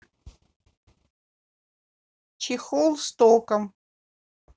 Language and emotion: Russian, neutral